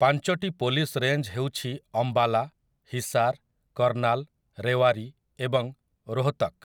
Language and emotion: Odia, neutral